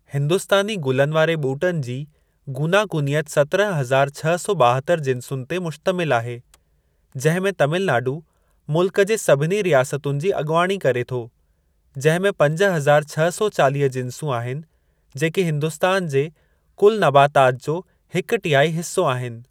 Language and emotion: Sindhi, neutral